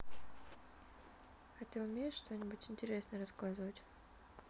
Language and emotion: Russian, neutral